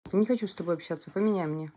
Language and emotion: Russian, angry